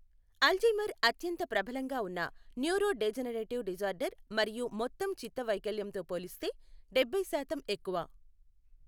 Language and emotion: Telugu, neutral